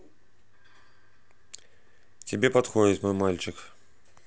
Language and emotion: Russian, neutral